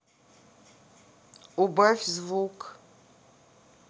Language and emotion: Russian, neutral